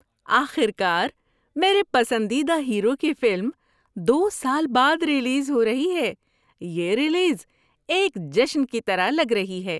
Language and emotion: Urdu, happy